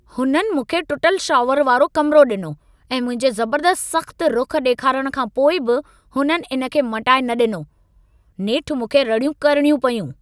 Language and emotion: Sindhi, angry